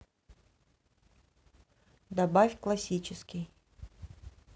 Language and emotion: Russian, neutral